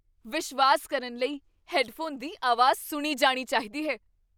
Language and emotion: Punjabi, surprised